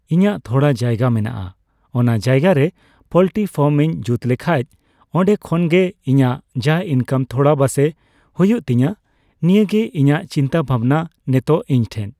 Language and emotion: Santali, neutral